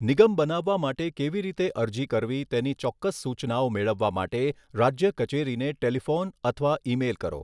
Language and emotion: Gujarati, neutral